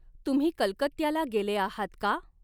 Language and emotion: Marathi, neutral